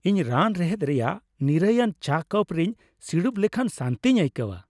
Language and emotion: Santali, happy